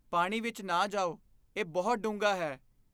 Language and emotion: Punjabi, fearful